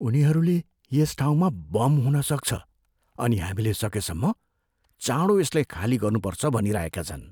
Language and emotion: Nepali, fearful